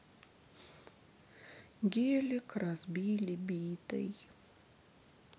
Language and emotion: Russian, sad